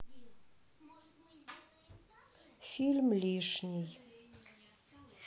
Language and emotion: Russian, sad